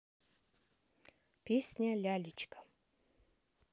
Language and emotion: Russian, neutral